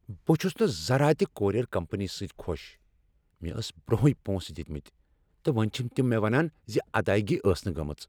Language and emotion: Kashmiri, angry